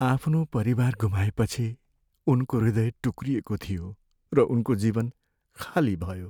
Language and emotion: Nepali, sad